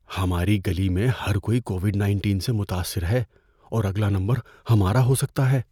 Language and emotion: Urdu, fearful